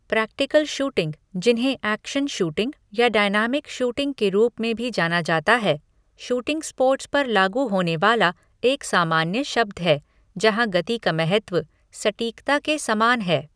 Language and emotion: Hindi, neutral